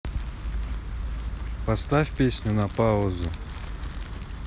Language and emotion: Russian, neutral